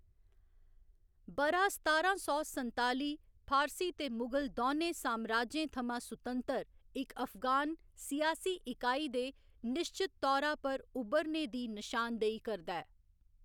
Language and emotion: Dogri, neutral